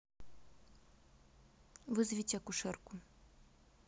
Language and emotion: Russian, neutral